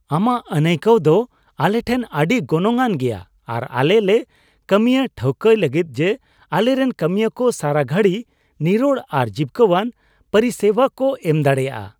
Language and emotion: Santali, happy